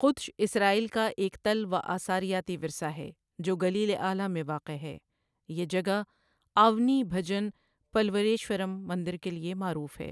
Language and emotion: Urdu, neutral